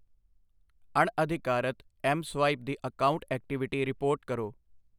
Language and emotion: Punjabi, neutral